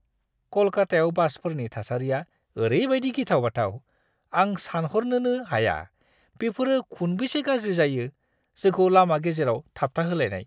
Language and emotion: Bodo, disgusted